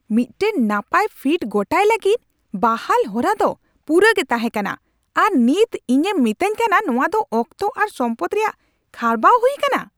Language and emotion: Santali, angry